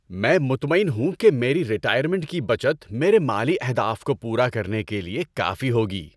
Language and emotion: Urdu, happy